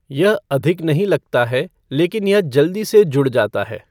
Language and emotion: Hindi, neutral